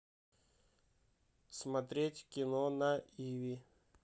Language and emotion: Russian, neutral